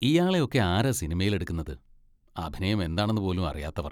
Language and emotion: Malayalam, disgusted